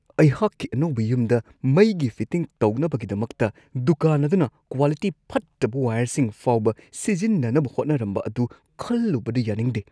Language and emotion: Manipuri, disgusted